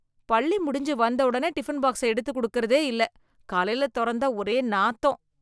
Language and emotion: Tamil, disgusted